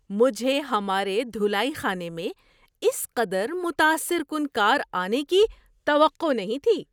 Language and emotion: Urdu, surprised